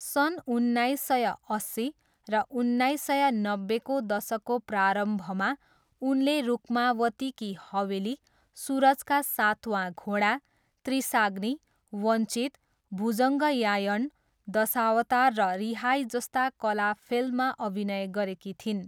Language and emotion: Nepali, neutral